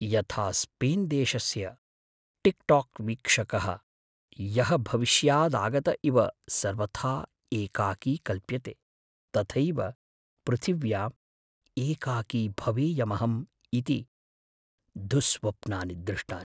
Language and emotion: Sanskrit, fearful